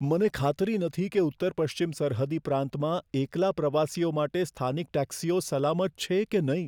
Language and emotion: Gujarati, fearful